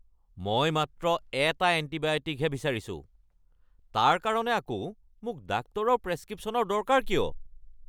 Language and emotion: Assamese, angry